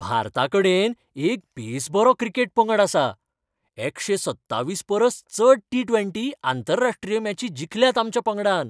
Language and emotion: Goan Konkani, happy